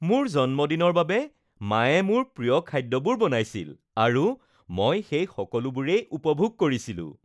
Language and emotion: Assamese, happy